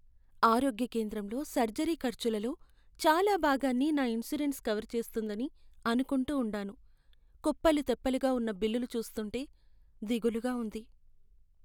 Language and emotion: Telugu, sad